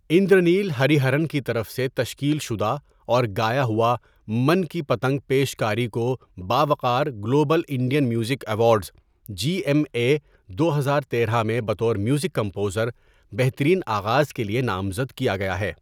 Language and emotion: Urdu, neutral